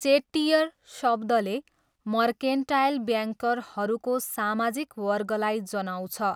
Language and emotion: Nepali, neutral